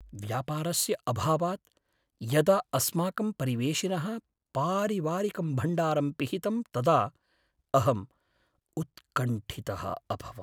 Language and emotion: Sanskrit, sad